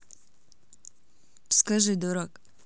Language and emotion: Russian, neutral